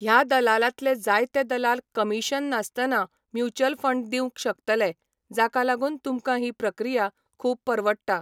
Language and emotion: Goan Konkani, neutral